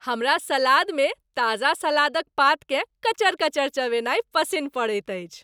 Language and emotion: Maithili, happy